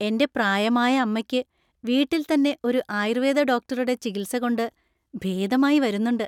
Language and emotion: Malayalam, happy